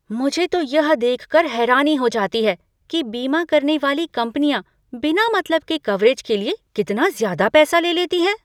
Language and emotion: Hindi, surprised